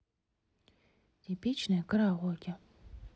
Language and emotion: Russian, neutral